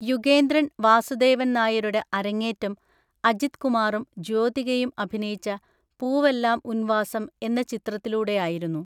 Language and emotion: Malayalam, neutral